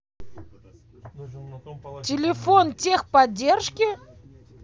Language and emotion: Russian, angry